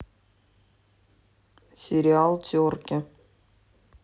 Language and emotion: Russian, neutral